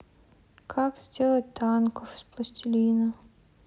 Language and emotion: Russian, sad